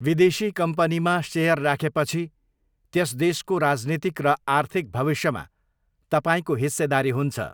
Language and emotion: Nepali, neutral